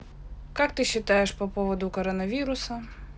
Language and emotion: Russian, neutral